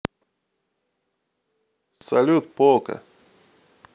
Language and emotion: Russian, neutral